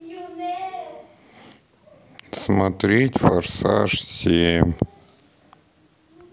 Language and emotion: Russian, sad